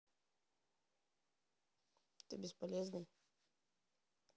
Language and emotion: Russian, neutral